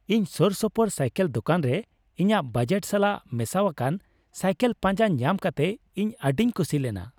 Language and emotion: Santali, happy